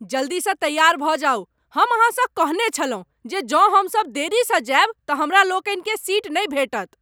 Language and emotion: Maithili, angry